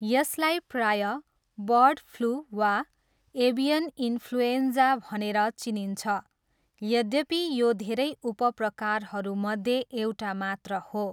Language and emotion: Nepali, neutral